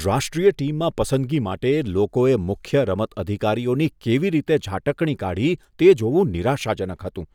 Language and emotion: Gujarati, disgusted